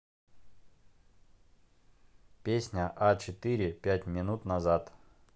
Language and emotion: Russian, neutral